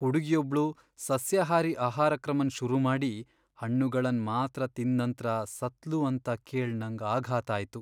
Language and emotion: Kannada, sad